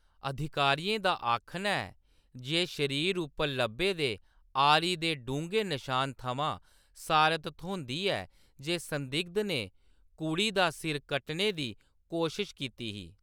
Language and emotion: Dogri, neutral